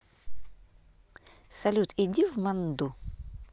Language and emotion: Russian, neutral